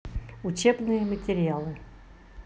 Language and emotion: Russian, neutral